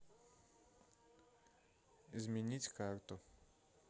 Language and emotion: Russian, neutral